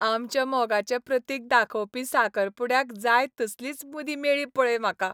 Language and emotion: Goan Konkani, happy